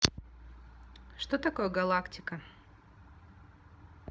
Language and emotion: Russian, neutral